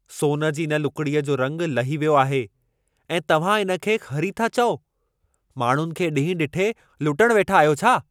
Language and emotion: Sindhi, angry